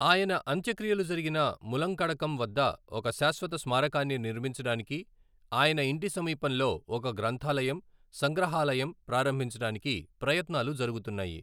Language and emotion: Telugu, neutral